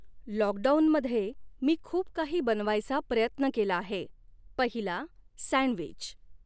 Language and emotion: Marathi, neutral